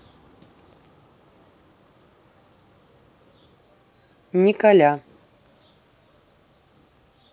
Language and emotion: Russian, neutral